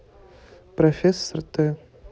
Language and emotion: Russian, neutral